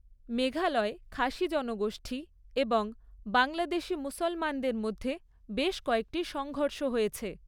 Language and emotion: Bengali, neutral